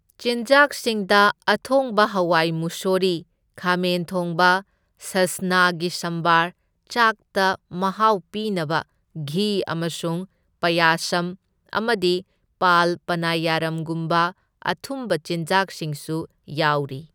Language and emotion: Manipuri, neutral